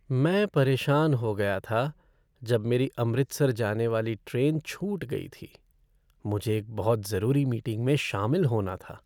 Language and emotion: Hindi, sad